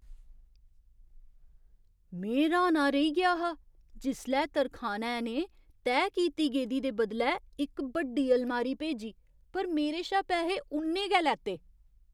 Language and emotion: Dogri, surprised